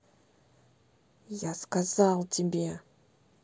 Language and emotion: Russian, angry